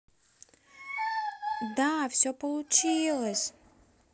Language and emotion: Russian, positive